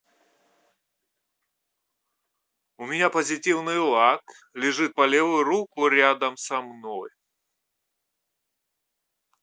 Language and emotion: Russian, positive